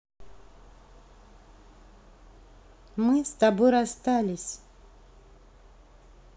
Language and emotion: Russian, neutral